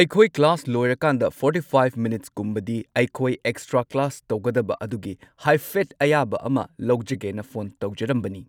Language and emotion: Manipuri, neutral